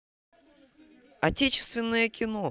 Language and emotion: Russian, positive